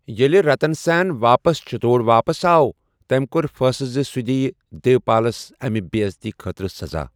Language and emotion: Kashmiri, neutral